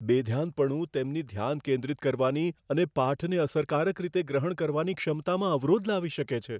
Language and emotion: Gujarati, fearful